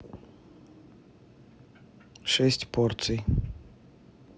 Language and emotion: Russian, neutral